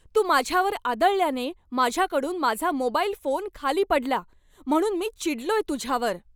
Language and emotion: Marathi, angry